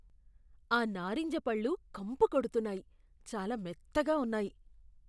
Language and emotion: Telugu, disgusted